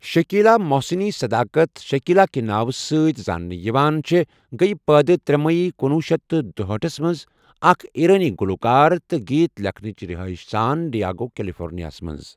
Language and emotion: Kashmiri, neutral